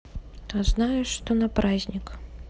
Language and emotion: Russian, neutral